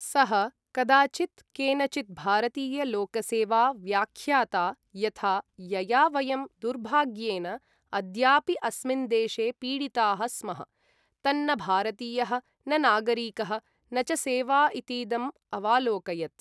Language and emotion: Sanskrit, neutral